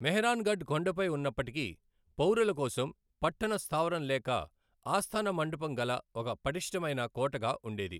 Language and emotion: Telugu, neutral